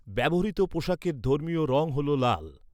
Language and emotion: Bengali, neutral